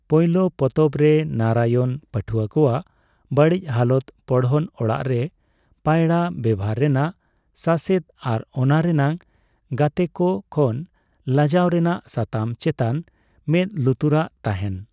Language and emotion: Santali, neutral